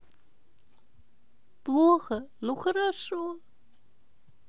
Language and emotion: Russian, sad